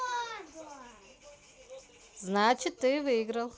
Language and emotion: Russian, neutral